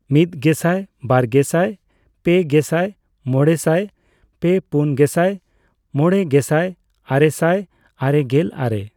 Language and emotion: Santali, neutral